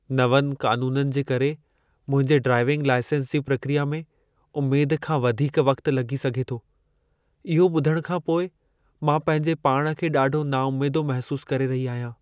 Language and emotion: Sindhi, sad